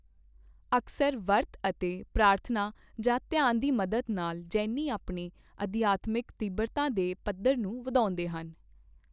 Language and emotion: Punjabi, neutral